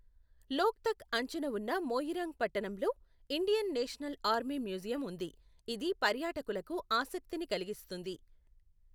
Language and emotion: Telugu, neutral